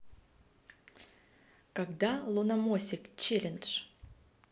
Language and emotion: Russian, neutral